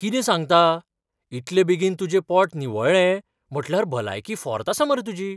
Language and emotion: Goan Konkani, surprised